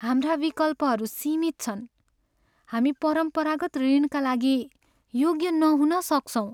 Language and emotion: Nepali, sad